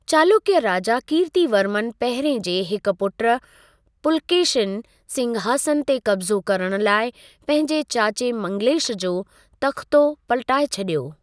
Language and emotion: Sindhi, neutral